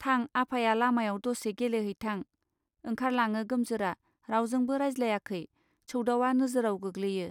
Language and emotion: Bodo, neutral